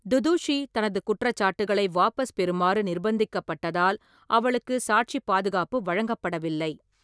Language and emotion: Tamil, neutral